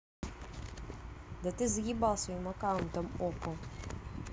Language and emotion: Russian, angry